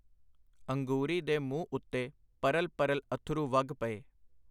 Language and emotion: Punjabi, neutral